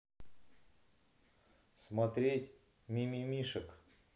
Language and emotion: Russian, neutral